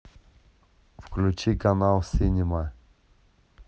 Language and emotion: Russian, neutral